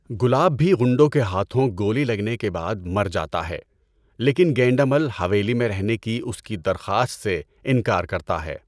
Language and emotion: Urdu, neutral